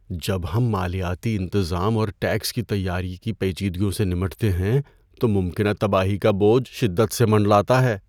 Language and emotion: Urdu, fearful